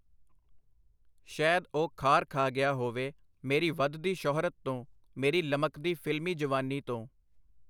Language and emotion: Punjabi, neutral